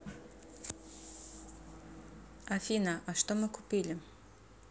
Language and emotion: Russian, neutral